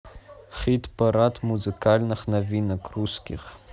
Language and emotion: Russian, neutral